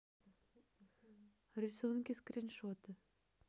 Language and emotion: Russian, neutral